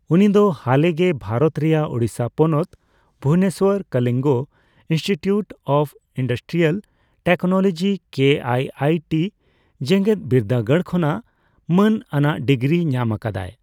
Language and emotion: Santali, neutral